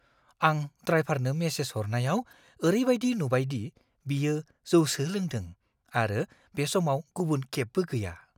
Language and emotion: Bodo, fearful